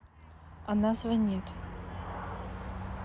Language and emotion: Russian, neutral